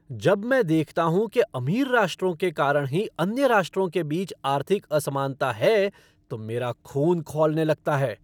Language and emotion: Hindi, angry